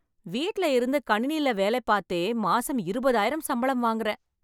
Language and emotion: Tamil, happy